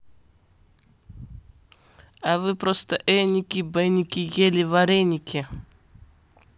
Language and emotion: Russian, neutral